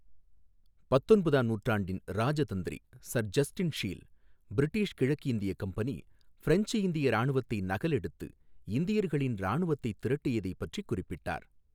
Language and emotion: Tamil, neutral